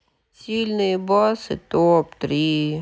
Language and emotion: Russian, sad